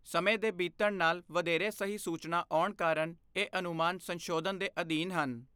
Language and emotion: Punjabi, neutral